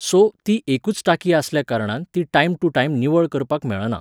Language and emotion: Goan Konkani, neutral